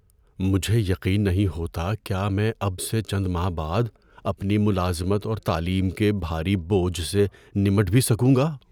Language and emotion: Urdu, fearful